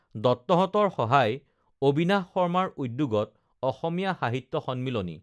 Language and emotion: Assamese, neutral